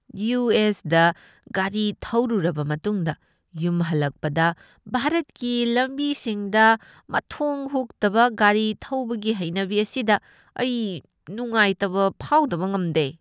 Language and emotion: Manipuri, disgusted